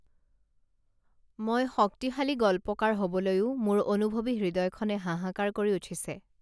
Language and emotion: Assamese, neutral